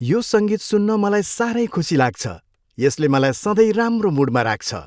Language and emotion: Nepali, happy